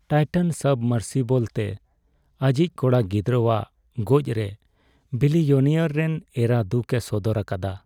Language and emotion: Santali, sad